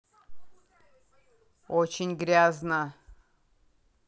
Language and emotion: Russian, angry